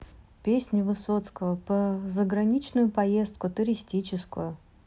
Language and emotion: Russian, neutral